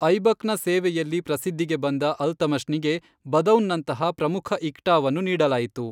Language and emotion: Kannada, neutral